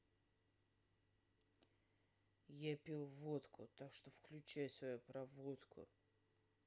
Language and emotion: Russian, angry